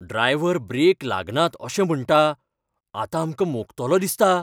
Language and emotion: Goan Konkani, fearful